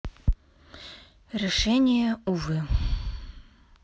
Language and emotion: Russian, sad